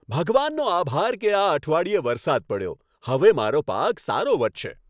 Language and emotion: Gujarati, happy